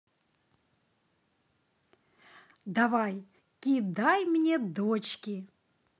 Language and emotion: Russian, positive